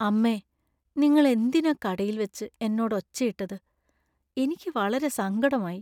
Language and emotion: Malayalam, sad